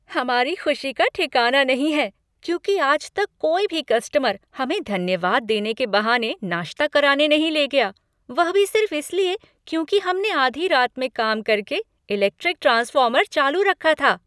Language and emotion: Hindi, happy